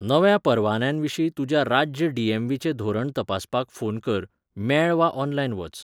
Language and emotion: Goan Konkani, neutral